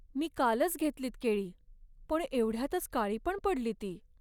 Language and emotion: Marathi, sad